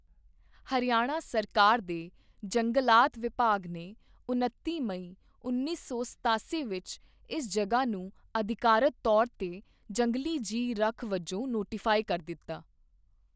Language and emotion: Punjabi, neutral